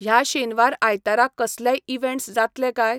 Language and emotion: Goan Konkani, neutral